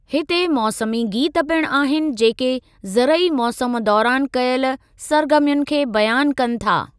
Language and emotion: Sindhi, neutral